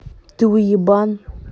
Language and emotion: Russian, angry